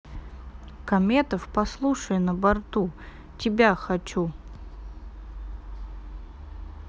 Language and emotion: Russian, neutral